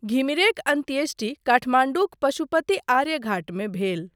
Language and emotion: Maithili, neutral